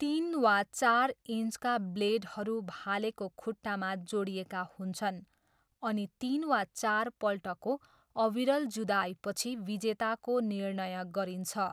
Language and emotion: Nepali, neutral